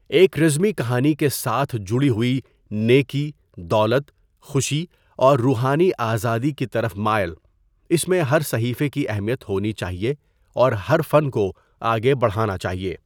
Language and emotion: Urdu, neutral